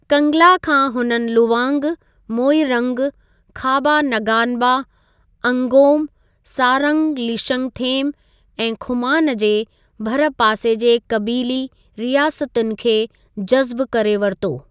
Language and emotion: Sindhi, neutral